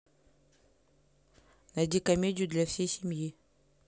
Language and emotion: Russian, neutral